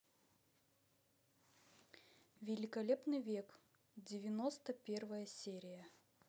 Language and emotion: Russian, neutral